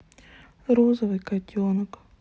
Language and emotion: Russian, sad